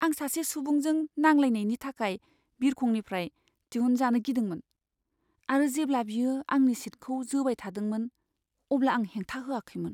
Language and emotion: Bodo, fearful